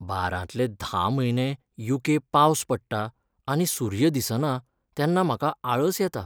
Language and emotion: Goan Konkani, sad